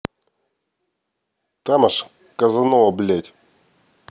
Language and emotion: Russian, angry